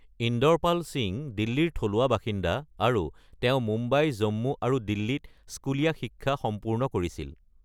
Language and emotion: Assamese, neutral